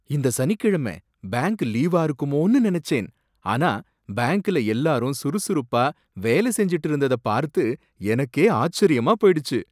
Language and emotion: Tamil, surprised